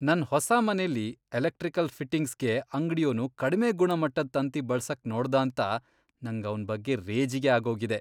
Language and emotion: Kannada, disgusted